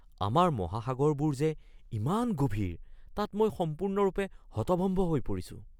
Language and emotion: Assamese, surprised